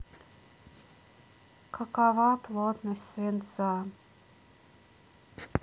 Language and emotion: Russian, sad